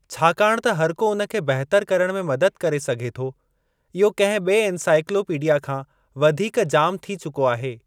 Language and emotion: Sindhi, neutral